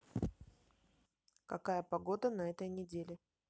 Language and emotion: Russian, neutral